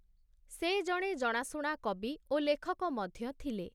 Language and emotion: Odia, neutral